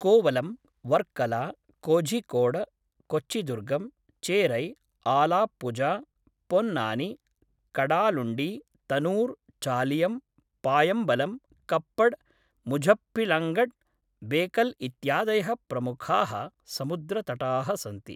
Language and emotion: Sanskrit, neutral